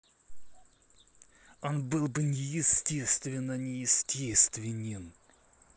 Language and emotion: Russian, angry